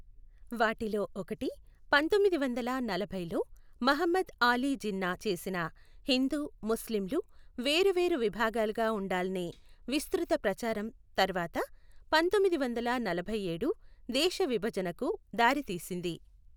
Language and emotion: Telugu, neutral